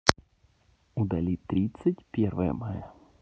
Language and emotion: Russian, neutral